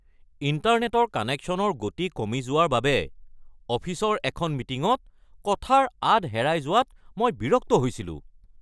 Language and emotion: Assamese, angry